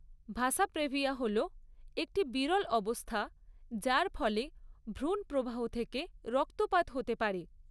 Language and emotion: Bengali, neutral